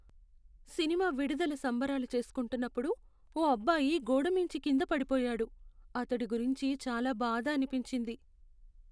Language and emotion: Telugu, sad